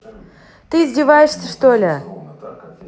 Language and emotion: Russian, angry